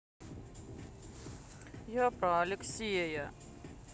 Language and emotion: Russian, sad